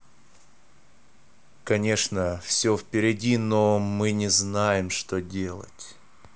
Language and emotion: Russian, neutral